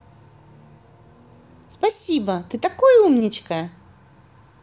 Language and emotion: Russian, positive